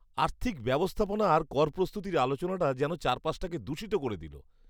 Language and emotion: Bengali, disgusted